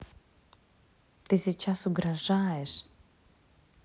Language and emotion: Russian, neutral